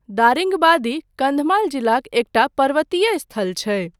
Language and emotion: Maithili, neutral